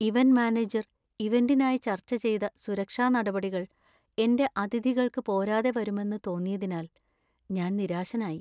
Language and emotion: Malayalam, sad